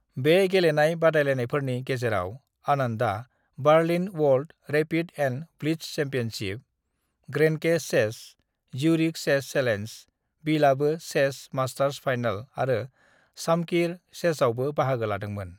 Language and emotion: Bodo, neutral